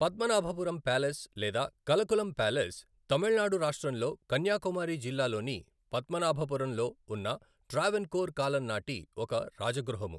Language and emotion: Telugu, neutral